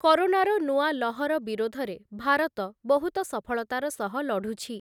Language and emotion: Odia, neutral